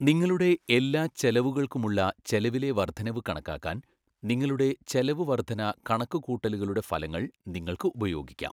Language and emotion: Malayalam, neutral